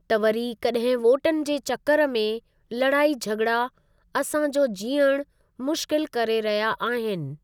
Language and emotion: Sindhi, neutral